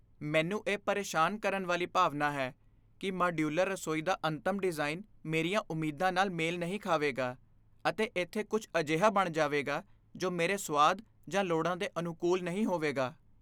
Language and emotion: Punjabi, fearful